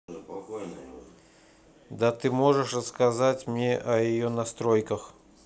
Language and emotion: Russian, neutral